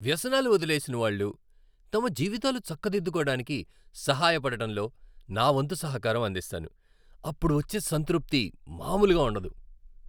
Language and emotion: Telugu, happy